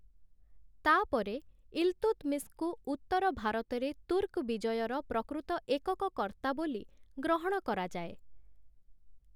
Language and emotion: Odia, neutral